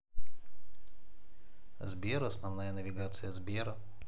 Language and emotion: Russian, neutral